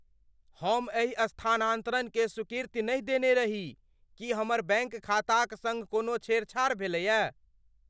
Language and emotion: Maithili, fearful